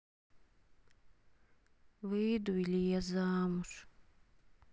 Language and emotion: Russian, sad